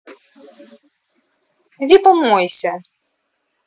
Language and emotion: Russian, angry